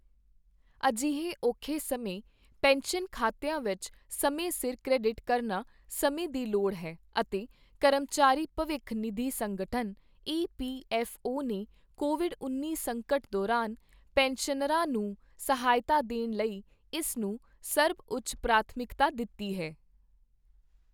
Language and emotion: Punjabi, neutral